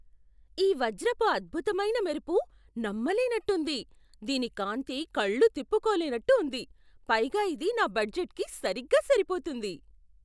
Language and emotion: Telugu, surprised